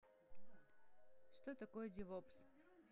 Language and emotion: Russian, neutral